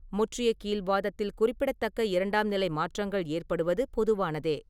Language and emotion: Tamil, neutral